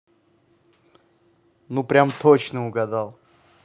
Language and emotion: Russian, positive